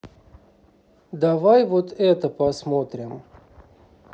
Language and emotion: Russian, neutral